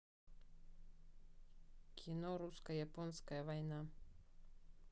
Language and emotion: Russian, neutral